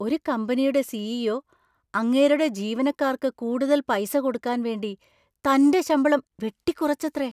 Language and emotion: Malayalam, surprised